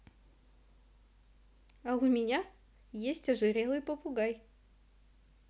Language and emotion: Russian, positive